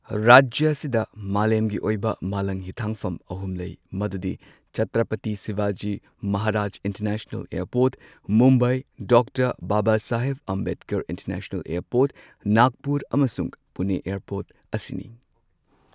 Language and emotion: Manipuri, neutral